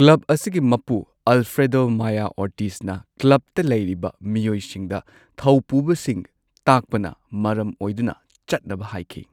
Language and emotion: Manipuri, neutral